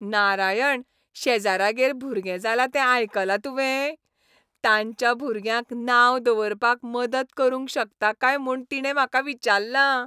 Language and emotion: Goan Konkani, happy